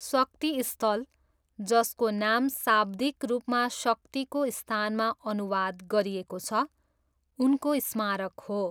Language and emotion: Nepali, neutral